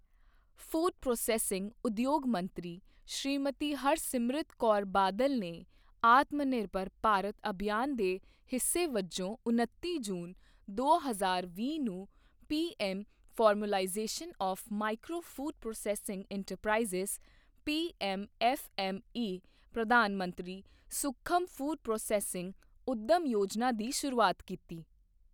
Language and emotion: Punjabi, neutral